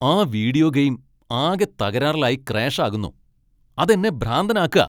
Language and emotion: Malayalam, angry